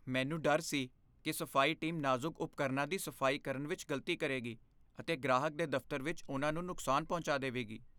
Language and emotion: Punjabi, fearful